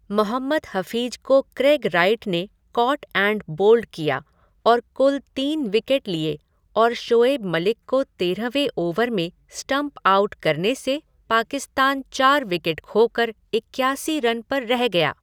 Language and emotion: Hindi, neutral